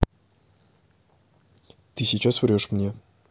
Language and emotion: Russian, neutral